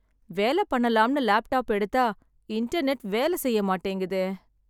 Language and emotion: Tamil, sad